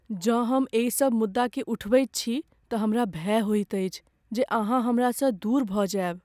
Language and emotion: Maithili, fearful